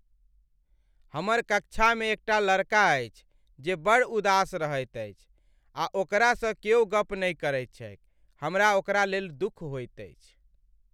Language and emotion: Maithili, sad